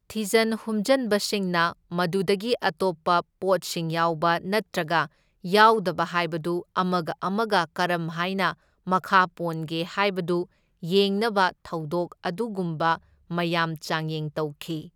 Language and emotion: Manipuri, neutral